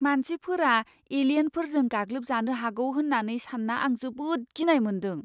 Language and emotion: Bodo, fearful